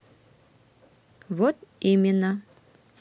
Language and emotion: Russian, neutral